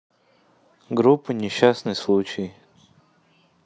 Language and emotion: Russian, neutral